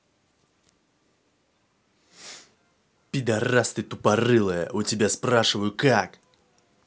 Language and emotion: Russian, angry